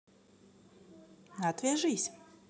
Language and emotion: Russian, neutral